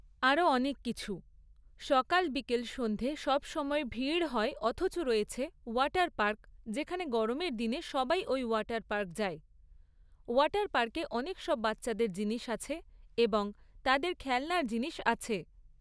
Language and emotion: Bengali, neutral